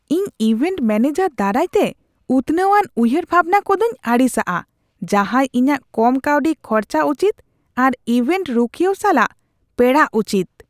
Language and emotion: Santali, disgusted